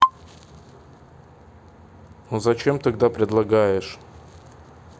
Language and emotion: Russian, neutral